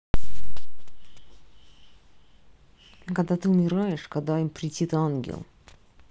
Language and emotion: Russian, neutral